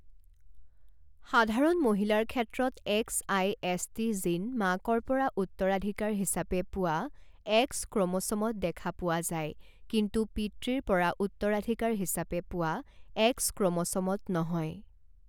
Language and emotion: Assamese, neutral